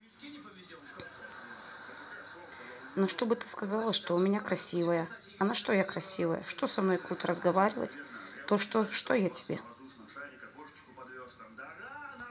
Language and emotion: Russian, sad